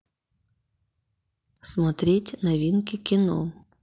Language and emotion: Russian, neutral